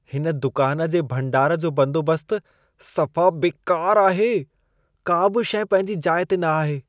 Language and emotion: Sindhi, disgusted